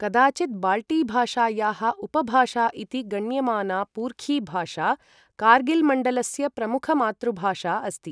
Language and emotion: Sanskrit, neutral